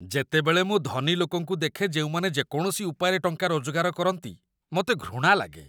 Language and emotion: Odia, disgusted